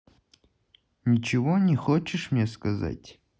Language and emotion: Russian, neutral